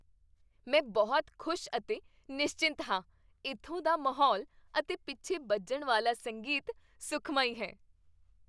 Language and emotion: Punjabi, happy